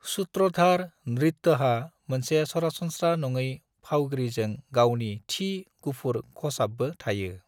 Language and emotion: Bodo, neutral